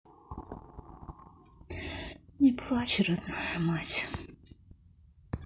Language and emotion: Russian, sad